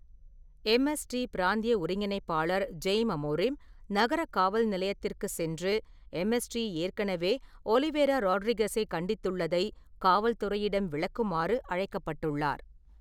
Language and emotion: Tamil, neutral